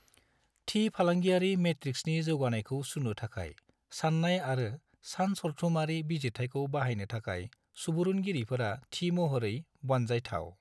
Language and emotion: Bodo, neutral